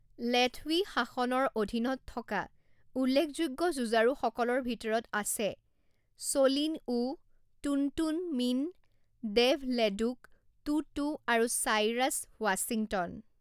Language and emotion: Assamese, neutral